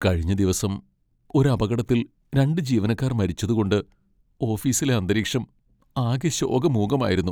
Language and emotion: Malayalam, sad